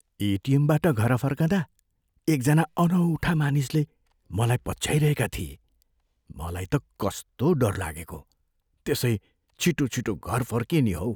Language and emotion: Nepali, fearful